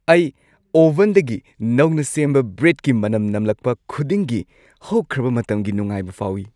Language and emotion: Manipuri, happy